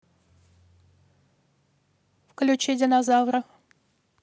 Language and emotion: Russian, neutral